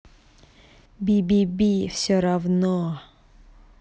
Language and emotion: Russian, angry